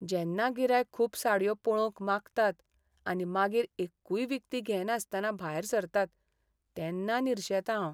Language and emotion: Goan Konkani, sad